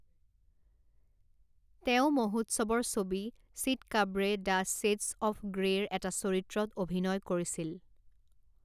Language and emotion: Assamese, neutral